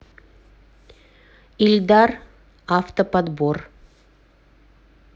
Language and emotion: Russian, neutral